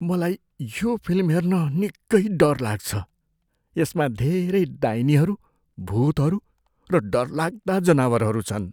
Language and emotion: Nepali, fearful